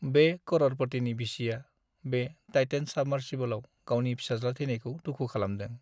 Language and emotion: Bodo, sad